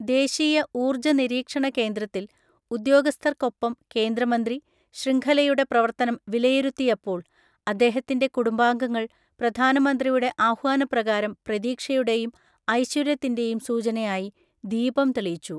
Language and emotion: Malayalam, neutral